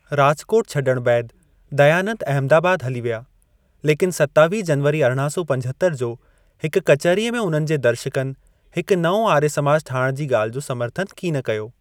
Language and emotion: Sindhi, neutral